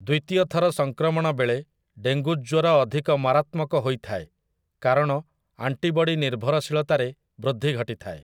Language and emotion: Odia, neutral